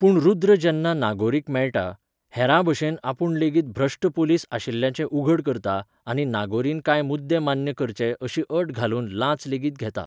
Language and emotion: Goan Konkani, neutral